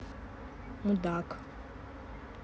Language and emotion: Russian, neutral